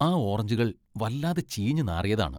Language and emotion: Malayalam, disgusted